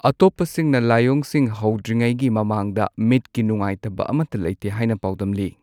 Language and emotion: Manipuri, neutral